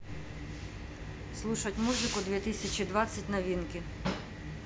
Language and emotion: Russian, neutral